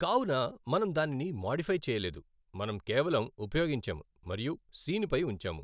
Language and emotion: Telugu, neutral